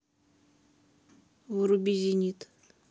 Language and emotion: Russian, neutral